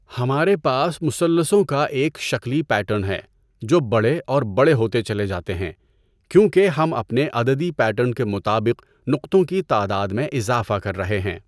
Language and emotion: Urdu, neutral